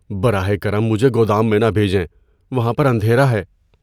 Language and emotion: Urdu, fearful